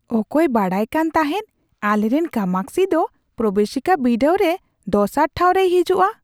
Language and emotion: Santali, surprised